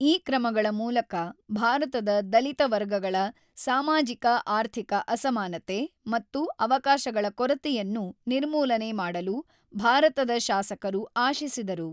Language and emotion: Kannada, neutral